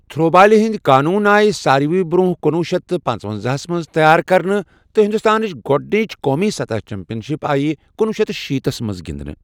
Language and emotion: Kashmiri, neutral